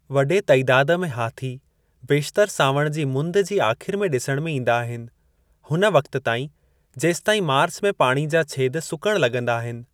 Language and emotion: Sindhi, neutral